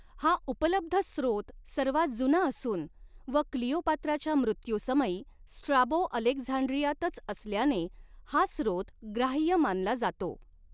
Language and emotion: Marathi, neutral